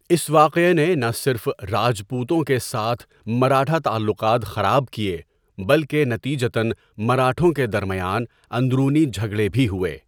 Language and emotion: Urdu, neutral